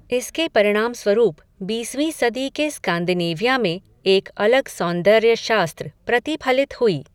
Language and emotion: Hindi, neutral